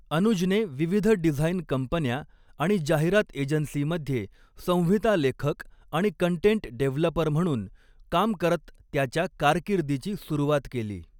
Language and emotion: Marathi, neutral